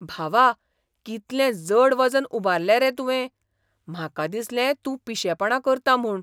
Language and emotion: Goan Konkani, surprised